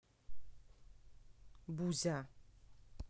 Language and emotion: Russian, neutral